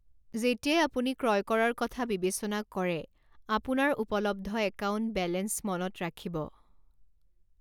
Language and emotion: Assamese, neutral